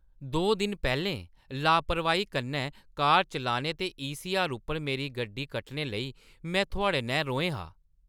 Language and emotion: Dogri, angry